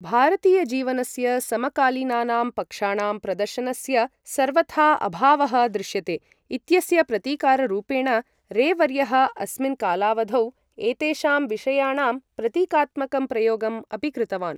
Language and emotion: Sanskrit, neutral